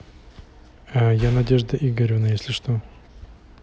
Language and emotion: Russian, neutral